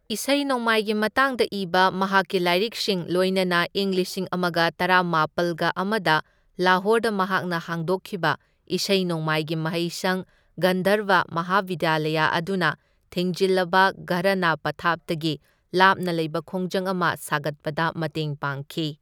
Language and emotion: Manipuri, neutral